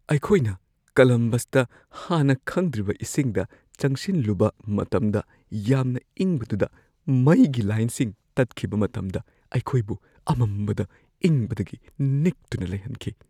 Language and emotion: Manipuri, fearful